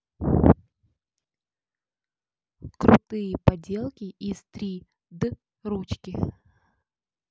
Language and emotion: Russian, neutral